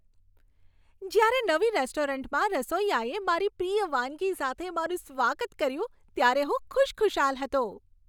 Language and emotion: Gujarati, happy